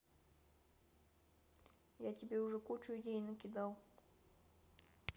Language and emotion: Russian, neutral